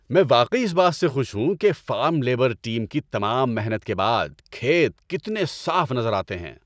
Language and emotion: Urdu, happy